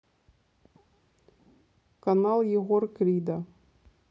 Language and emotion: Russian, neutral